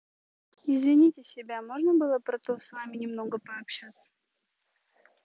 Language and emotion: Russian, neutral